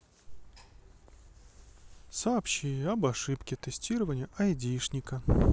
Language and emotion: Russian, neutral